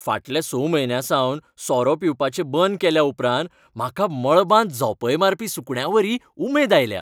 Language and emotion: Goan Konkani, happy